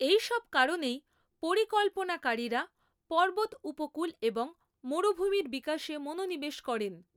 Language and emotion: Bengali, neutral